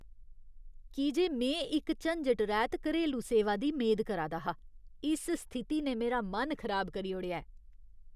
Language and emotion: Dogri, disgusted